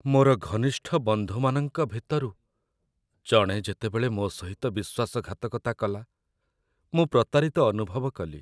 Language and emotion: Odia, sad